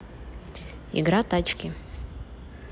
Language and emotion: Russian, neutral